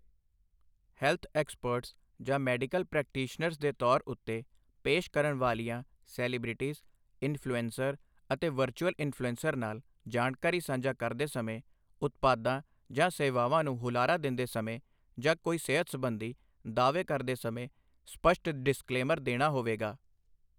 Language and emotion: Punjabi, neutral